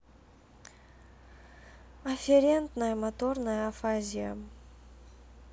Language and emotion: Russian, sad